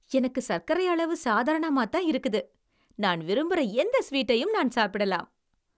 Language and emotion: Tamil, happy